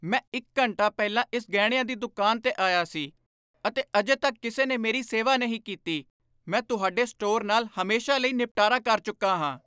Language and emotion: Punjabi, angry